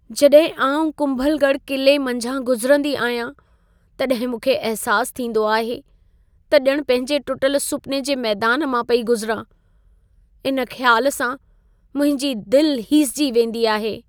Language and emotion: Sindhi, sad